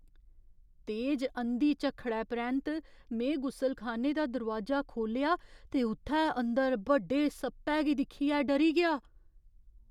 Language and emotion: Dogri, fearful